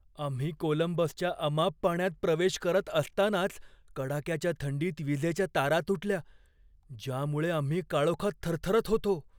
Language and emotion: Marathi, fearful